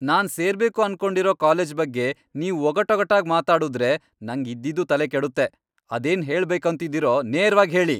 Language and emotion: Kannada, angry